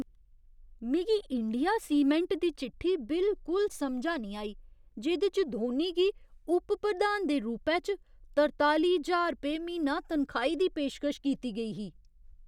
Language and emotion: Dogri, surprised